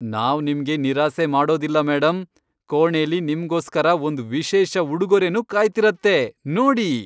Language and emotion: Kannada, happy